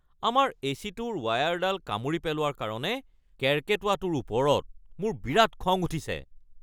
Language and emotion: Assamese, angry